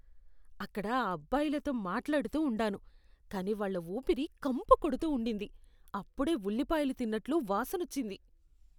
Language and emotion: Telugu, disgusted